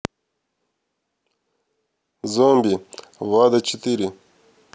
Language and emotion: Russian, neutral